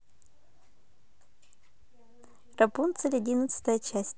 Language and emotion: Russian, positive